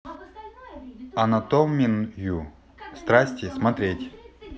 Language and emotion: Russian, neutral